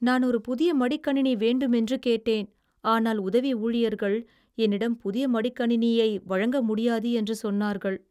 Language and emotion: Tamil, sad